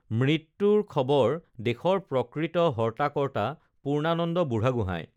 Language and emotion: Assamese, neutral